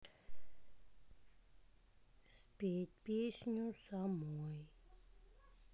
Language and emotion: Russian, sad